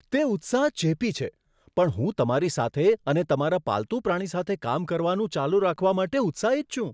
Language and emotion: Gujarati, surprised